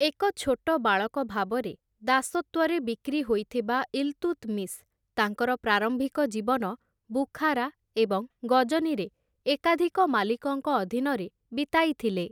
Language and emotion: Odia, neutral